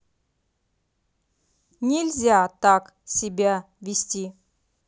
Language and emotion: Russian, angry